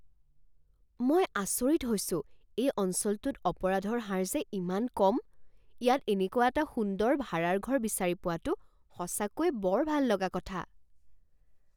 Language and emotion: Assamese, surprised